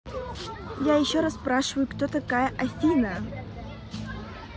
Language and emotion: Russian, angry